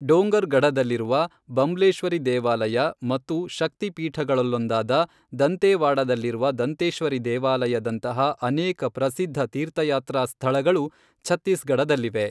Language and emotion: Kannada, neutral